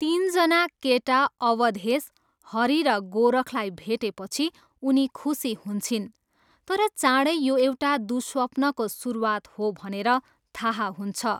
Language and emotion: Nepali, neutral